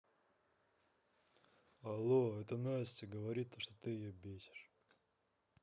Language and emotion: Russian, neutral